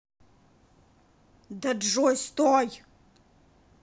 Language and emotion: Russian, angry